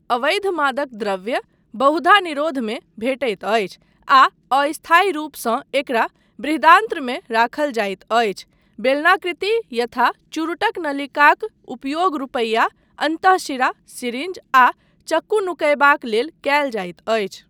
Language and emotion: Maithili, neutral